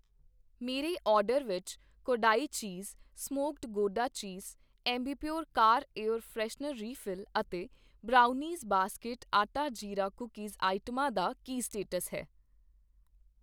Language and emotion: Punjabi, neutral